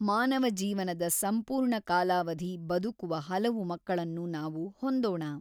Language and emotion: Kannada, neutral